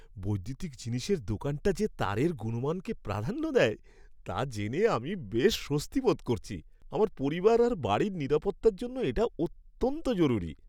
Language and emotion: Bengali, happy